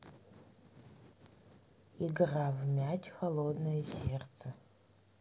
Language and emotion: Russian, neutral